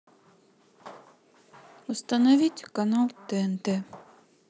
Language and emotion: Russian, sad